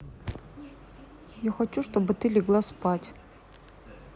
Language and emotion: Russian, neutral